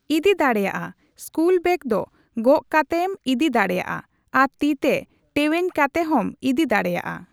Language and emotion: Santali, neutral